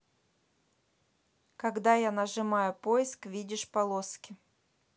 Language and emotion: Russian, neutral